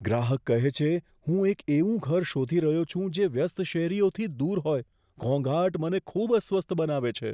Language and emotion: Gujarati, fearful